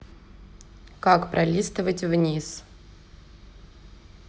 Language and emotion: Russian, neutral